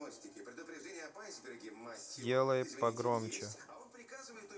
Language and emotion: Russian, neutral